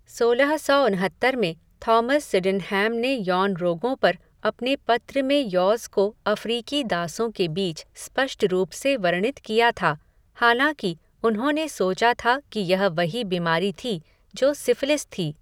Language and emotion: Hindi, neutral